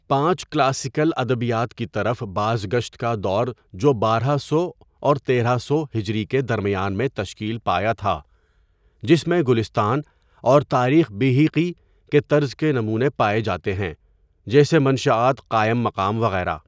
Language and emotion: Urdu, neutral